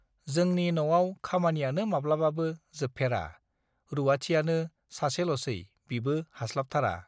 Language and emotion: Bodo, neutral